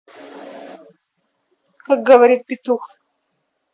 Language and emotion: Russian, neutral